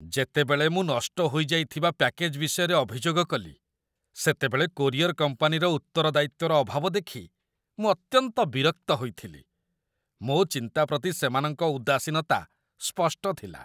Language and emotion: Odia, disgusted